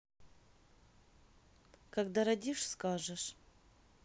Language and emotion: Russian, neutral